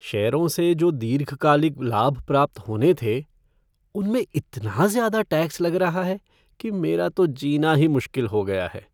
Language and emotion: Hindi, sad